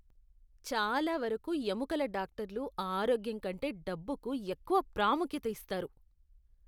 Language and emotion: Telugu, disgusted